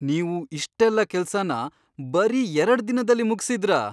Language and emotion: Kannada, surprised